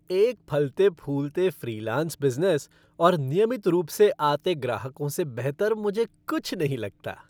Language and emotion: Hindi, happy